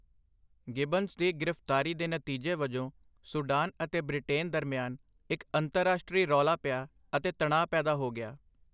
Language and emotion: Punjabi, neutral